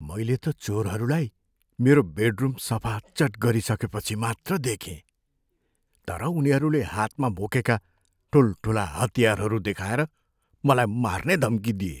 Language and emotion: Nepali, fearful